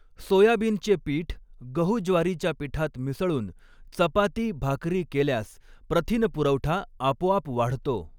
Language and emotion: Marathi, neutral